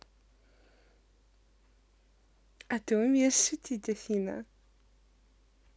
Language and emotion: Russian, positive